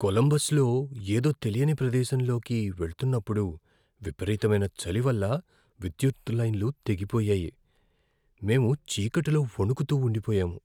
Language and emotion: Telugu, fearful